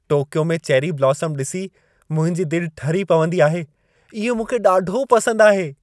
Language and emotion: Sindhi, happy